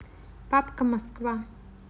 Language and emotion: Russian, neutral